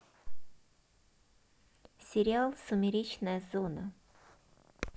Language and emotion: Russian, neutral